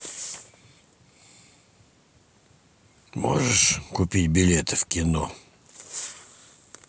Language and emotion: Russian, neutral